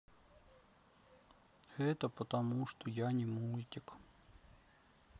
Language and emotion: Russian, sad